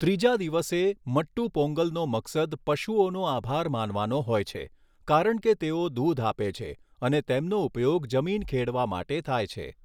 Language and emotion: Gujarati, neutral